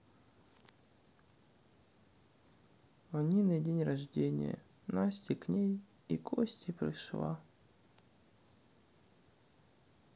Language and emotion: Russian, sad